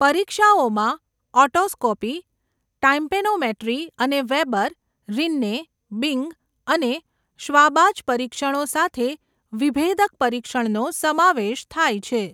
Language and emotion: Gujarati, neutral